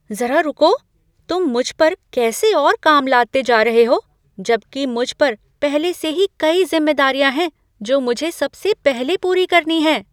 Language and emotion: Hindi, surprised